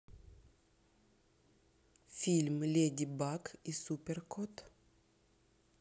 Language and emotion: Russian, neutral